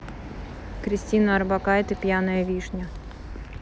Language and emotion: Russian, neutral